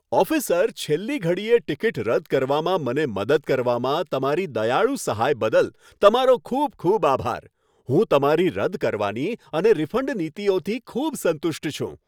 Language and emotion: Gujarati, happy